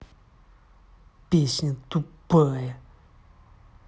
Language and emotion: Russian, angry